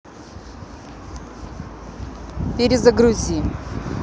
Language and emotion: Russian, neutral